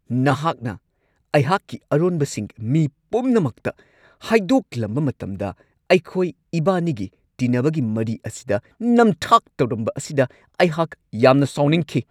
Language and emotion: Manipuri, angry